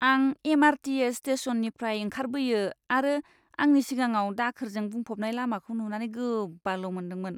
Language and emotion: Bodo, disgusted